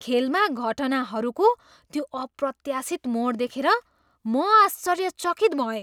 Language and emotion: Nepali, surprised